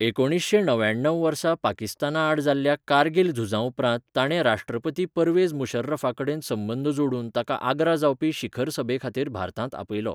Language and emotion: Goan Konkani, neutral